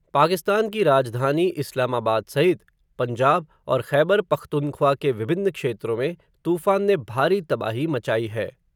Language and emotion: Hindi, neutral